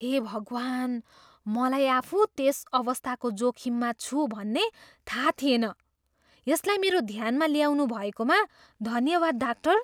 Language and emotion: Nepali, surprised